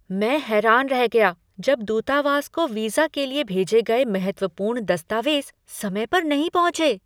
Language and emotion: Hindi, surprised